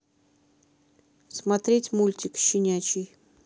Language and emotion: Russian, neutral